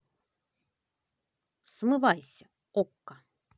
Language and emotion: Russian, positive